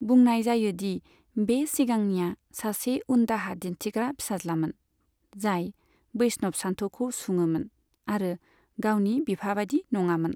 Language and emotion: Bodo, neutral